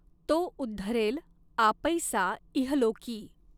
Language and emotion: Marathi, neutral